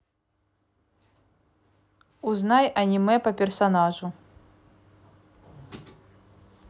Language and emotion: Russian, neutral